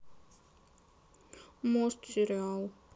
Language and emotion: Russian, sad